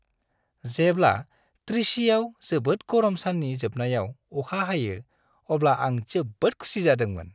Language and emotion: Bodo, happy